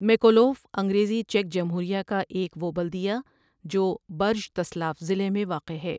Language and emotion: Urdu, neutral